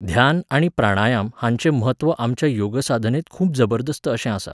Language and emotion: Goan Konkani, neutral